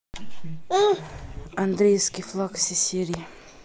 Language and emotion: Russian, neutral